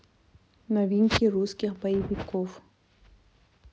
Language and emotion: Russian, neutral